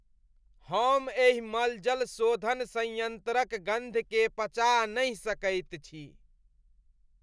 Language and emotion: Maithili, disgusted